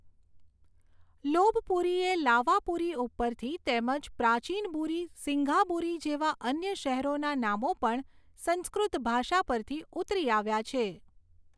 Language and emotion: Gujarati, neutral